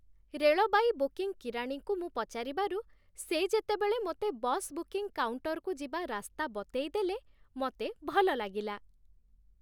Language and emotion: Odia, happy